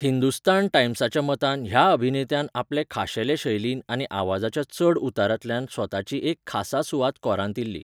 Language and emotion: Goan Konkani, neutral